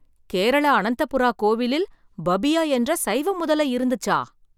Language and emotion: Tamil, surprised